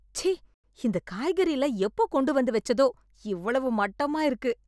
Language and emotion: Tamil, disgusted